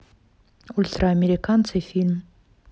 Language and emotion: Russian, neutral